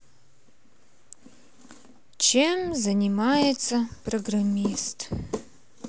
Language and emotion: Russian, sad